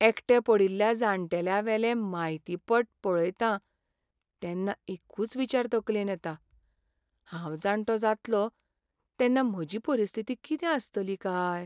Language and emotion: Goan Konkani, sad